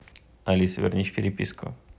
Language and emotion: Russian, neutral